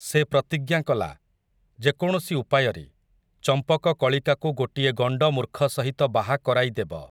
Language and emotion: Odia, neutral